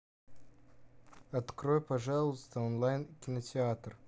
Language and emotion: Russian, neutral